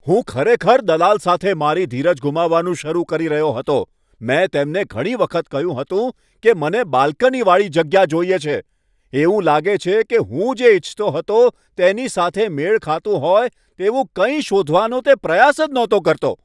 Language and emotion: Gujarati, angry